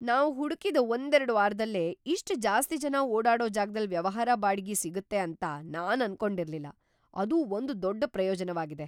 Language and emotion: Kannada, surprised